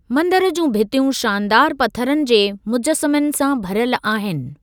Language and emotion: Sindhi, neutral